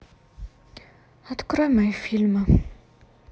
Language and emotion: Russian, sad